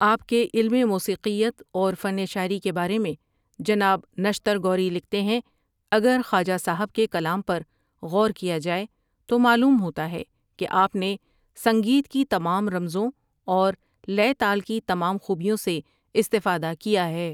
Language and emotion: Urdu, neutral